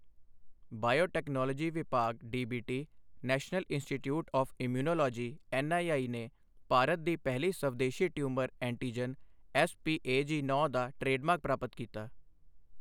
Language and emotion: Punjabi, neutral